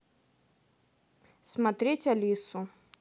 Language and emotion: Russian, neutral